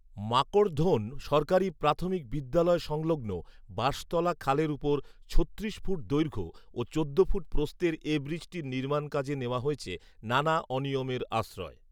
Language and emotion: Bengali, neutral